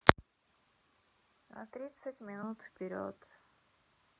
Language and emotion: Russian, sad